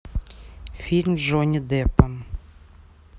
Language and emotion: Russian, neutral